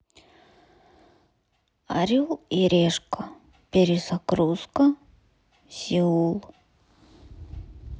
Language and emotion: Russian, sad